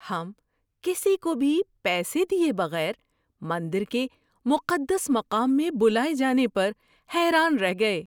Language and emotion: Urdu, surprised